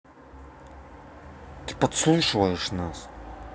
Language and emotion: Russian, angry